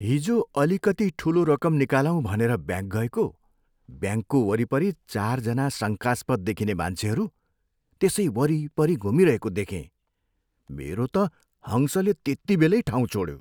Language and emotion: Nepali, fearful